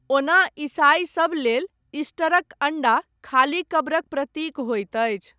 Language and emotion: Maithili, neutral